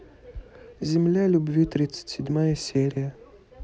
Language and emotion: Russian, neutral